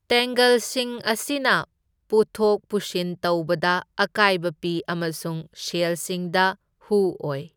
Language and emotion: Manipuri, neutral